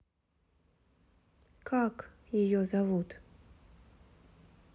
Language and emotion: Russian, neutral